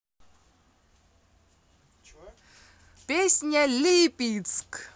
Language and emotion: Russian, positive